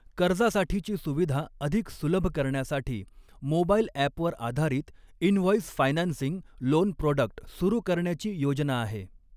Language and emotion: Marathi, neutral